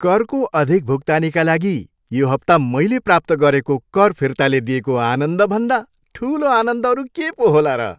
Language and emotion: Nepali, happy